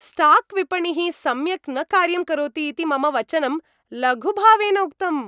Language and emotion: Sanskrit, happy